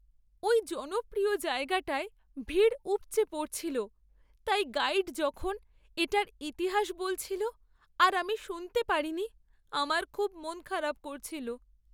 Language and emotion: Bengali, sad